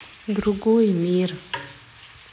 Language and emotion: Russian, sad